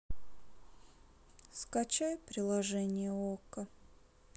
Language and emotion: Russian, sad